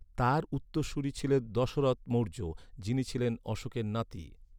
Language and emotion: Bengali, neutral